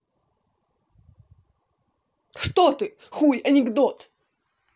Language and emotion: Russian, angry